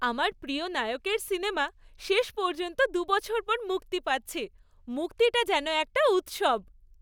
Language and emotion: Bengali, happy